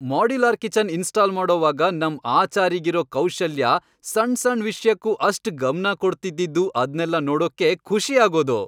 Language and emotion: Kannada, happy